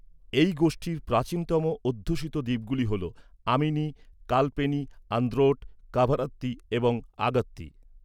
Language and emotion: Bengali, neutral